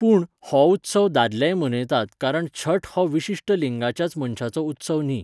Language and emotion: Goan Konkani, neutral